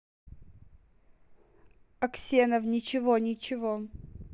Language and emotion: Russian, neutral